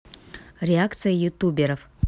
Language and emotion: Russian, neutral